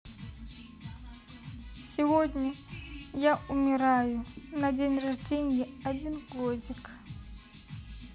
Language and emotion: Russian, sad